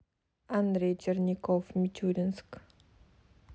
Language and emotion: Russian, neutral